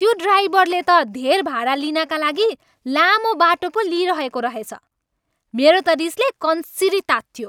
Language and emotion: Nepali, angry